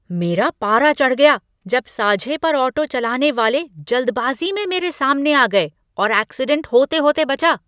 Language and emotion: Hindi, angry